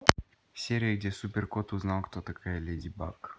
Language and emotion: Russian, neutral